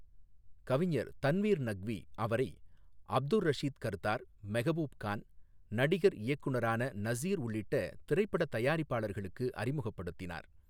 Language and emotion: Tamil, neutral